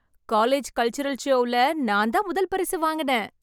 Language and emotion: Tamil, happy